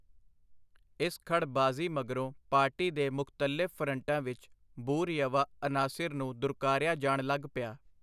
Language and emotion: Punjabi, neutral